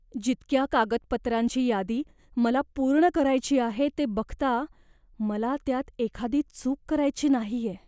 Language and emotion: Marathi, fearful